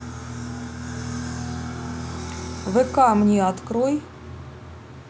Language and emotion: Russian, neutral